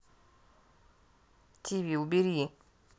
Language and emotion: Russian, neutral